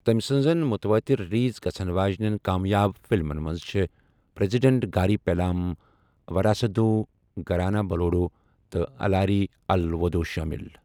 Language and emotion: Kashmiri, neutral